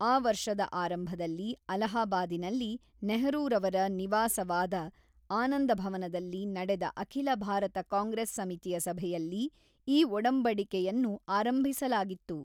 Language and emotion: Kannada, neutral